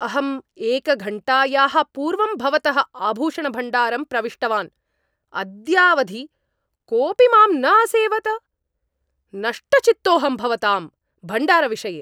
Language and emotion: Sanskrit, angry